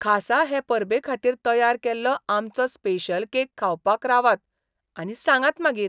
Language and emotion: Goan Konkani, surprised